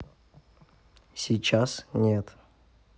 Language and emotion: Russian, neutral